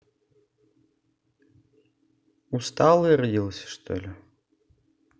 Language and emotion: Russian, neutral